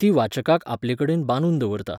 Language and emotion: Goan Konkani, neutral